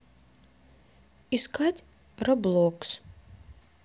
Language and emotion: Russian, neutral